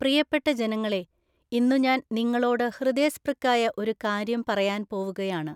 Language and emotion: Malayalam, neutral